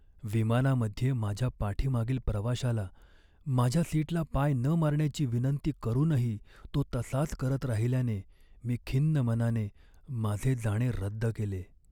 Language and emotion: Marathi, sad